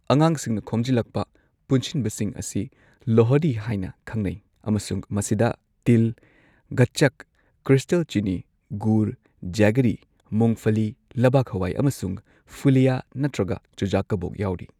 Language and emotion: Manipuri, neutral